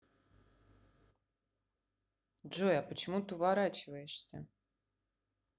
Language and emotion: Russian, neutral